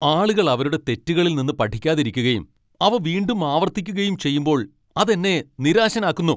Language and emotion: Malayalam, angry